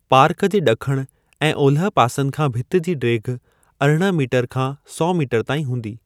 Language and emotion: Sindhi, neutral